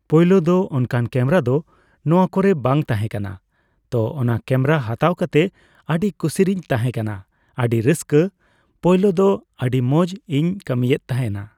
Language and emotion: Santali, neutral